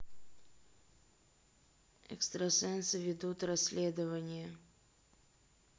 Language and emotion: Russian, neutral